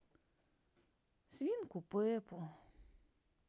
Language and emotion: Russian, sad